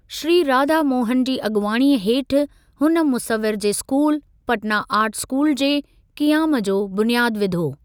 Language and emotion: Sindhi, neutral